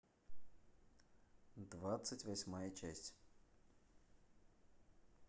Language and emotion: Russian, neutral